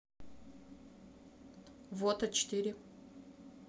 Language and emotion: Russian, neutral